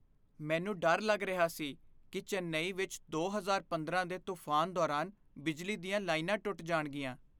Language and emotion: Punjabi, fearful